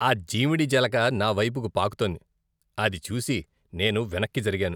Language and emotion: Telugu, disgusted